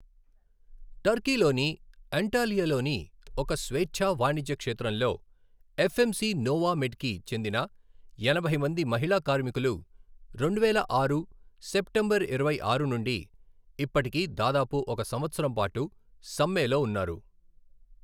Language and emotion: Telugu, neutral